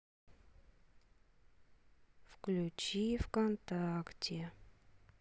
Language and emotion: Russian, sad